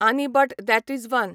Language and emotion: Goan Konkani, neutral